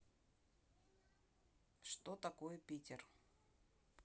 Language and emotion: Russian, neutral